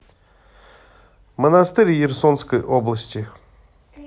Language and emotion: Russian, neutral